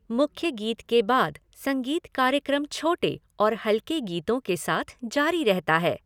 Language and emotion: Hindi, neutral